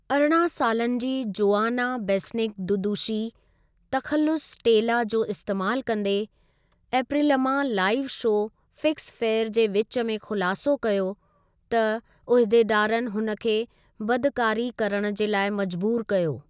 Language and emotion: Sindhi, neutral